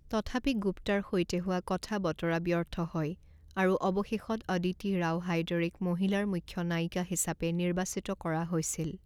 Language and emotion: Assamese, neutral